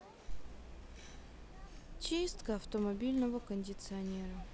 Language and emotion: Russian, sad